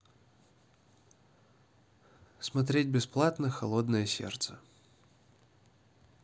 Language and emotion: Russian, neutral